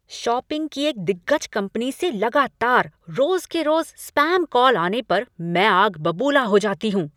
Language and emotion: Hindi, angry